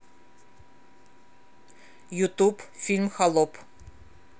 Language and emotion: Russian, neutral